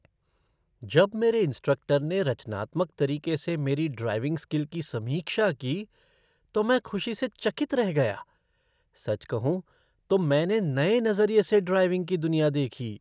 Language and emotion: Hindi, surprised